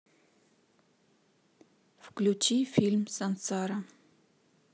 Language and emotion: Russian, neutral